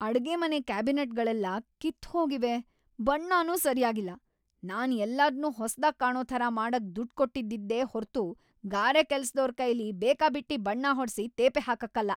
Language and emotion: Kannada, angry